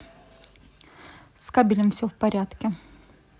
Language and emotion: Russian, neutral